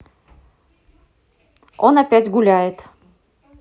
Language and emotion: Russian, angry